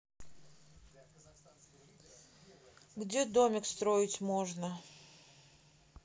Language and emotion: Russian, neutral